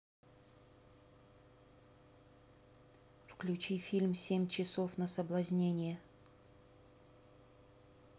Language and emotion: Russian, neutral